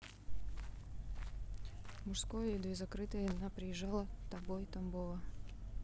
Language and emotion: Russian, neutral